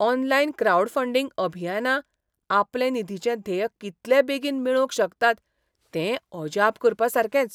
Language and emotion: Goan Konkani, surprised